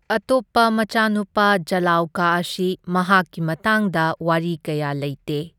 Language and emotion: Manipuri, neutral